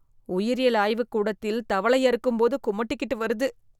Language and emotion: Tamil, disgusted